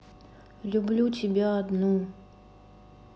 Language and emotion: Russian, neutral